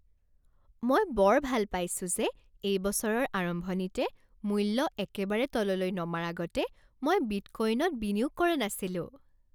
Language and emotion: Assamese, happy